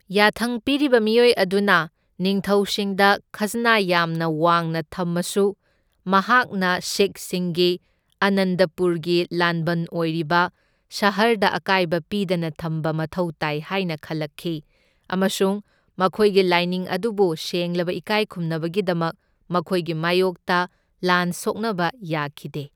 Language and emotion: Manipuri, neutral